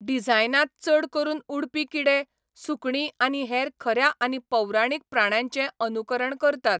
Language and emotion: Goan Konkani, neutral